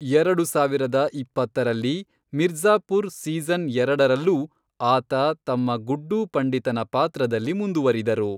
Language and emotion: Kannada, neutral